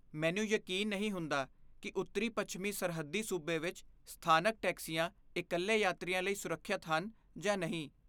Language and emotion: Punjabi, fearful